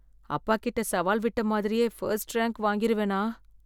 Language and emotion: Tamil, fearful